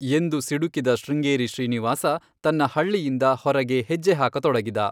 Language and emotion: Kannada, neutral